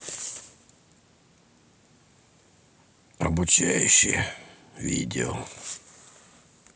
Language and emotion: Russian, neutral